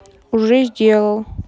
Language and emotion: Russian, neutral